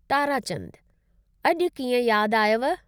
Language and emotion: Sindhi, neutral